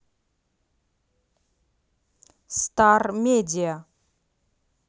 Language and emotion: Russian, neutral